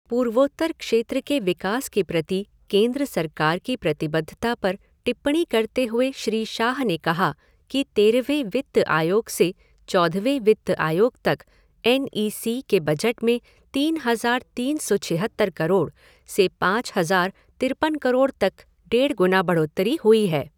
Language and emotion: Hindi, neutral